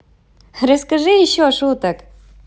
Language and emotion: Russian, positive